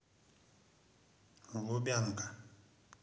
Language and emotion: Russian, neutral